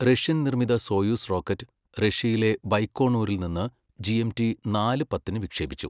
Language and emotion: Malayalam, neutral